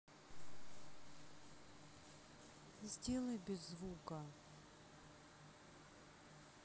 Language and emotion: Russian, sad